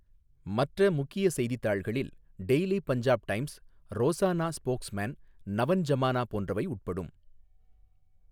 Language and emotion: Tamil, neutral